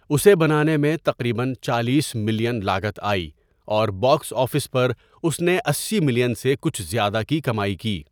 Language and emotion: Urdu, neutral